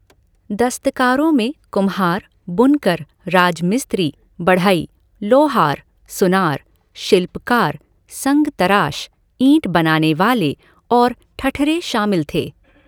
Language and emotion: Hindi, neutral